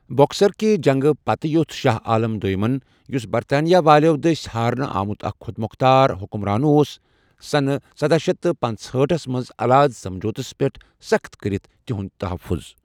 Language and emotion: Kashmiri, neutral